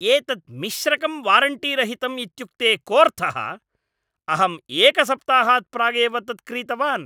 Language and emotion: Sanskrit, angry